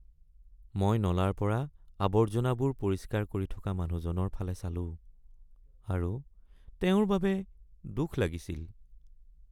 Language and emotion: Assamese, sad